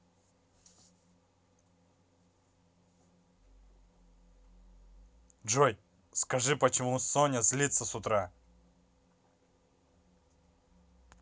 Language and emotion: Russian, angry